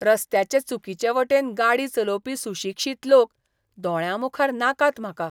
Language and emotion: Goan Konkani, disgusted